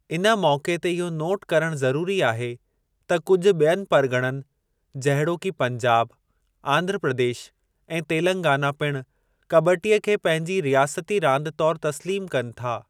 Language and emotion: Sindhi, neutral